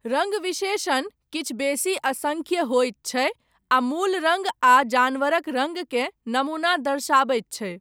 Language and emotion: Maithili, neutral